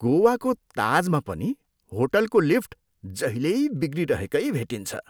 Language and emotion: Nepali, disgusted